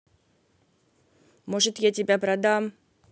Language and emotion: Russian, angry